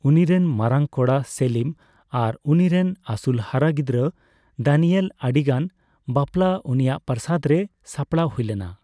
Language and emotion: Santali, neutral